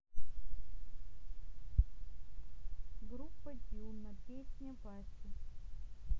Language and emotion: Russian, neutral